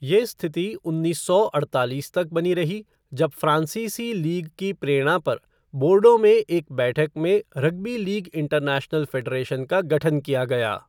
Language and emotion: Hindi, neutral